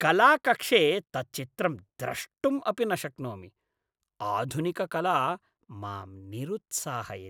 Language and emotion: Sanskrit, disgusted